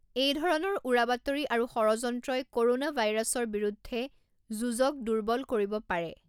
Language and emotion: Assamese, neutral